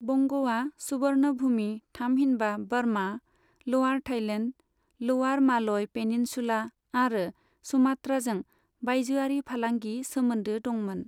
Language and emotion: Bodo, neutral